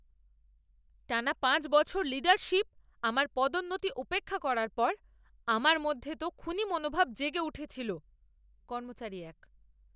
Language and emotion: Bengali, angry